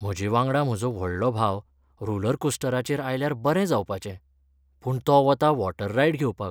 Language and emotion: Goan Konkani, sad